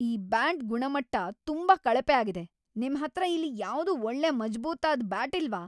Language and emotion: Kannada, angry